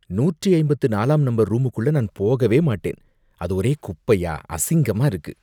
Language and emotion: Tamil, disgusted